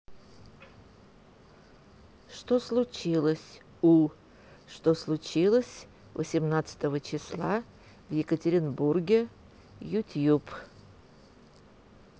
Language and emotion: Russian, neutral